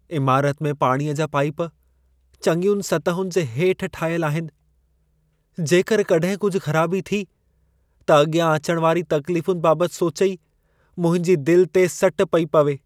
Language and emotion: Sindhi, sad